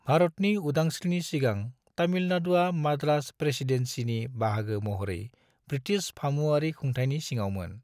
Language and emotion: Bodo, neutral